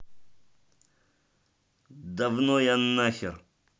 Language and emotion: Russian, angry